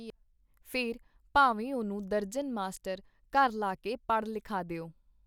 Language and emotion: Punjabi, neutral